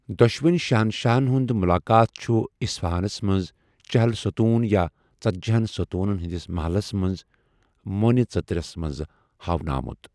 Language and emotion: Kashmiri, neutral